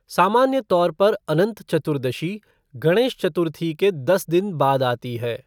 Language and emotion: Hindi, neutral